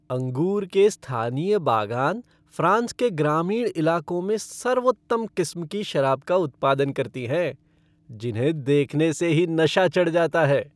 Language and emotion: Hindi, happy